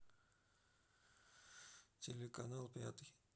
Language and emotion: Russian, neutral